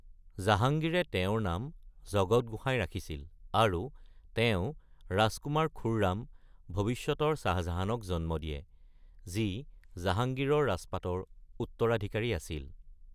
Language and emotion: Assamese, neutral